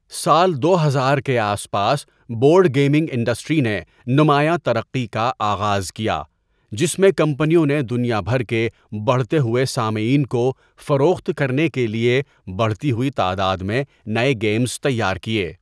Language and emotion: Urdu, neutral